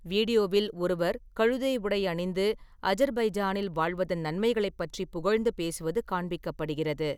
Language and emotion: Tamil, neutral